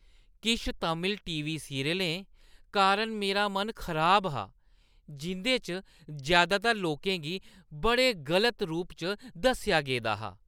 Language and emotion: Dogri, disgusted